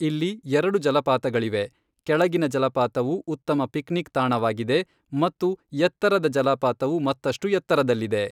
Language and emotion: Kannada, neutral